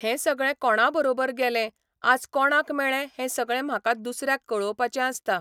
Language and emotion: Goan Konkani, neutral